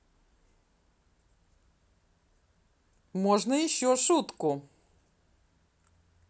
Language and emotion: Russian, positive